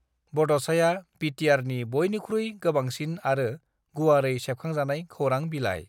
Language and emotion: Bodo, neutral